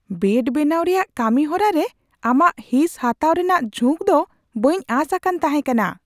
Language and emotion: Santali, surprised